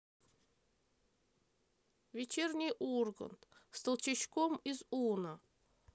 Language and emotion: Russian, sad